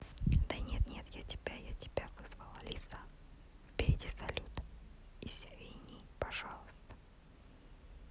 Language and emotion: Russian, neutral